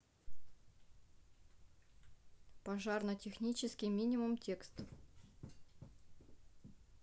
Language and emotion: Russian, neutral